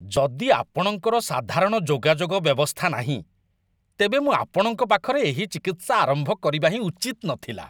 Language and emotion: Odia, disgusted